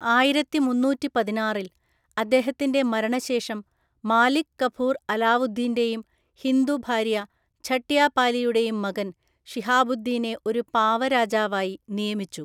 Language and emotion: Malayalam, neutral